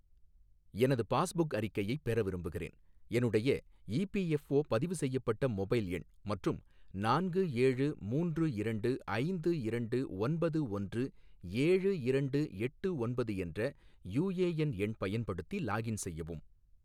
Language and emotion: Tamil, neutral